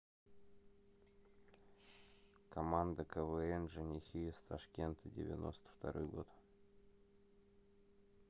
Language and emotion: Russian, neutral